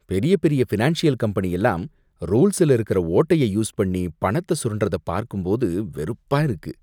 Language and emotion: Tamil, disgusted